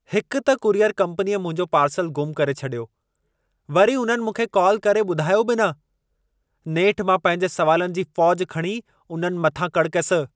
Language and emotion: Sindhi, angry